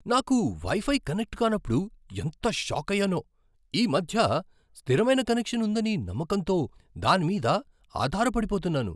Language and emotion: Telugu, surprised